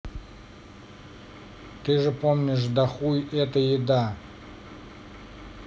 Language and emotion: Russian, neutral